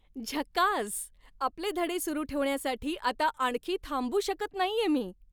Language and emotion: Marathi, happy